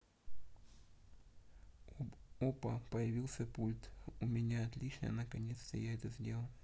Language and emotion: Russian, neutral